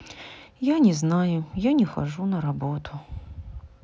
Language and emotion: Russian, sad